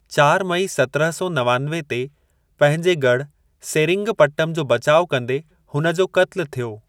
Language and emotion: Sindhi, neutral